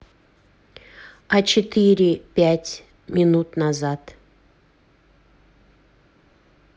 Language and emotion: Russian, neutral